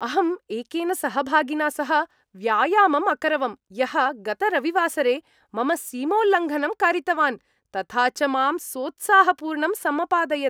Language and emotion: Sanskrit, happy